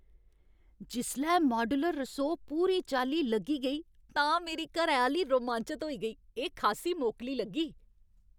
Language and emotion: Dogri, happy